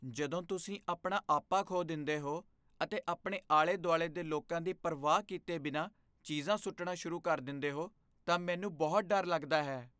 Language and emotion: Punjabi, fearful